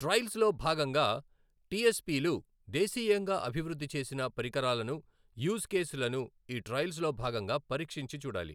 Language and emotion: Telugu, neutral